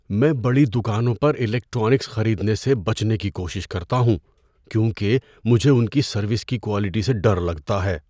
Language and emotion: Urdu, fearful